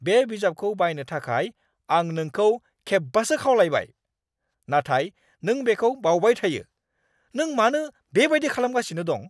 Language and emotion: Bodo, angry